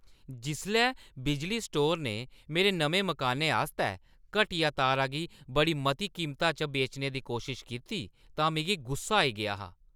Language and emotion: Dogri, angry